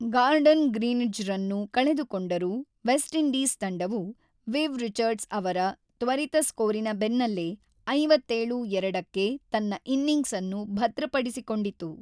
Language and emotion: Kannada, neutral